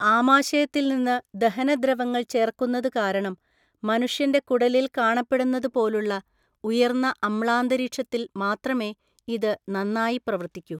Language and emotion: Malayalam, neutral